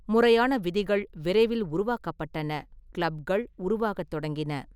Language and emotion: Tamil, neutral